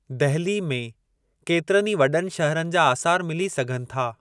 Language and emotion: Sindhi, neutral